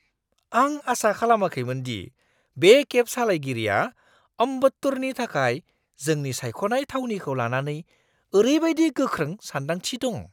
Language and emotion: Bodo, surprised